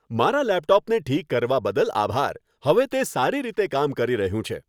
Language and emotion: Gujarati, happy